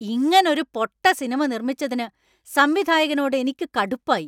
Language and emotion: Malayalam, angry